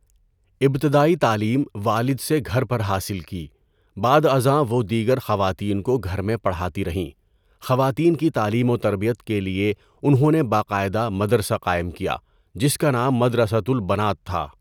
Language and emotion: Urdu, neutral